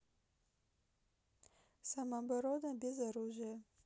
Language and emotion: Russian, neutral